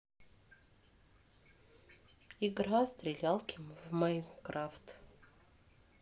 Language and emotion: Russian, neutral